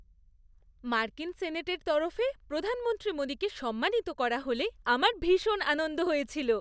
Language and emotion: Bengali, happy